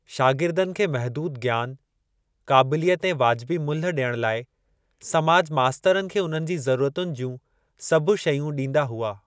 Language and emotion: Sindhi, neutral